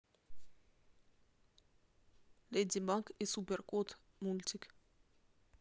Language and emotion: Russian, neutral